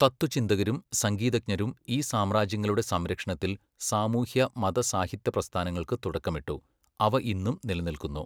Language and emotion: Malayalam, neutral